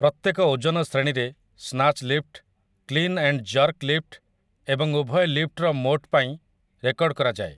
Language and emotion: Odia, neutral